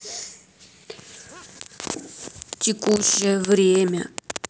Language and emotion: Russian, sad